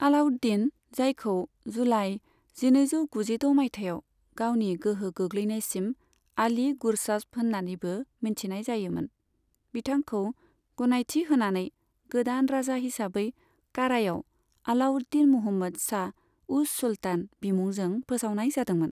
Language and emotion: Bodo, neutral